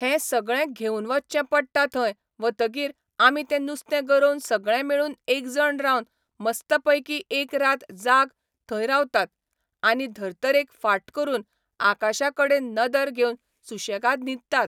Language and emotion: Goan Konkani, neutral